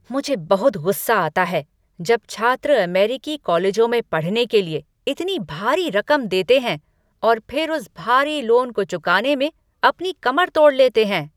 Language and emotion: Hindi, angry